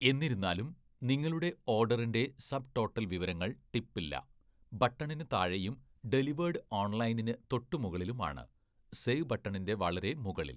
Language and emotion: Malayalam, neutral